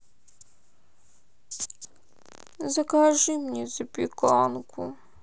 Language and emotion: Russian, sad